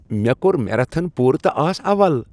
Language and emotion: Kashmiri, happy